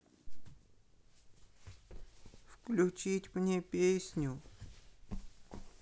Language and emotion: Russian, sad